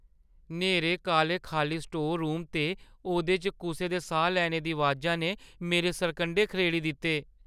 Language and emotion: Dogri, fearful